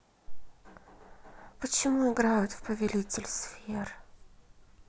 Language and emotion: Russian, neutral